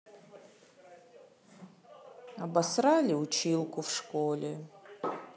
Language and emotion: Russian, sad